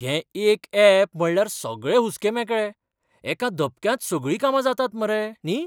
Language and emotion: Goan Konkani, surprised